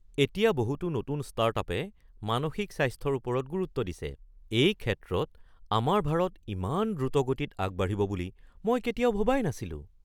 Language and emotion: Assamese, surprised